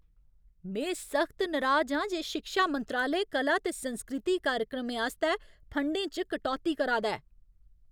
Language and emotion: Dogri, angry